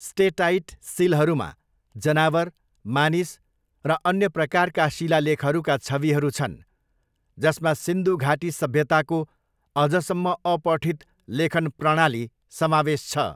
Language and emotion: Nepali, neutral